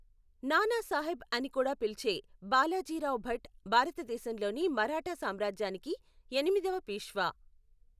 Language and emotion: Telugu, neutral